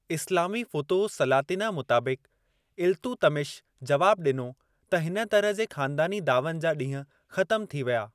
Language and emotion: Sindhi, neutral